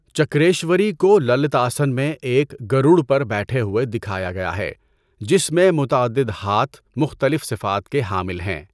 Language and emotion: Urdu, neutral